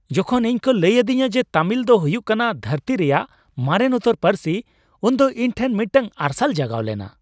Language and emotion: Santali, happy